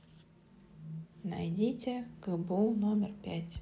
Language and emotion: Russian, neutral